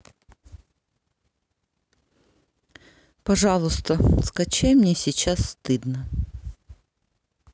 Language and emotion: Russian, neutral